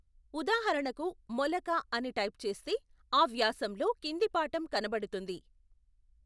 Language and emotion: Telugu, neutral